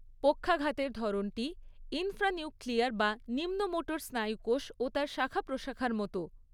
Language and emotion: Bengali, neutral